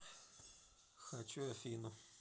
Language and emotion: Russian, neutral